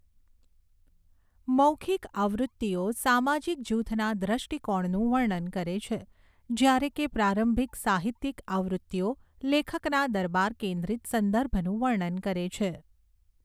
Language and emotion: Gujarati, neutral